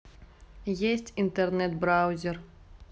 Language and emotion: Russian, neutral